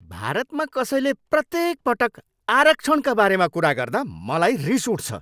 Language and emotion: Nepali, angry